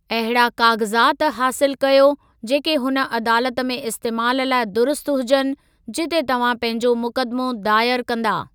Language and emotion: Sindhi, neutral